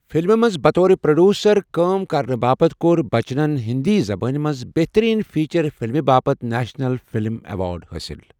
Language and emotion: Kashmiri, neutral